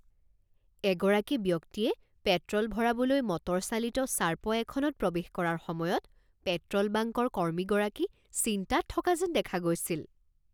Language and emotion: Assamese, surprised